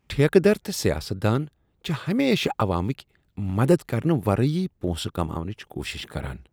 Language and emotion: Kashmiri, disgusted